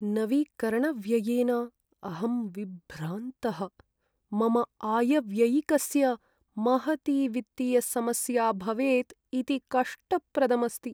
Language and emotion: Sanskrit, sad